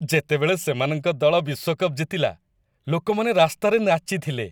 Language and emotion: Odia, happy